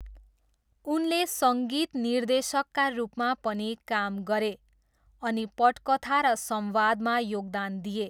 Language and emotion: Nepali, neutral